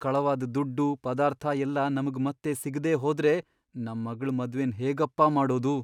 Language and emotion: Kannada, fearful